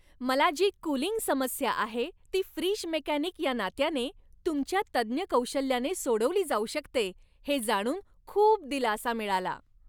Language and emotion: Marathi, happy